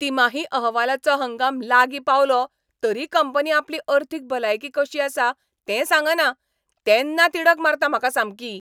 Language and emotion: Goan Konkani, angry